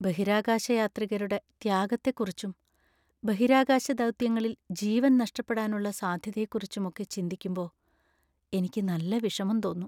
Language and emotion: Malayalam, sad